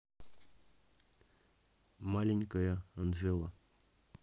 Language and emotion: Russian, neutral